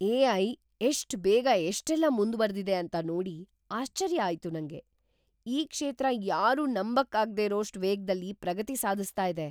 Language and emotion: Kannada, surprised